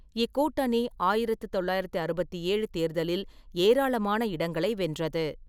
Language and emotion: Tamil, neutral